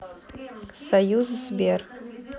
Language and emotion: Russian, neutral